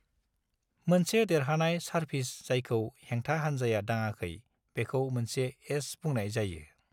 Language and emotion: Bodo, neutral